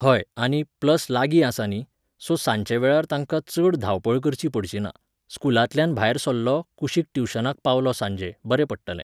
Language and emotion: Goan Konkani, neutral